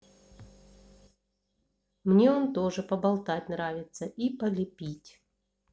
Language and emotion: Russian, neutral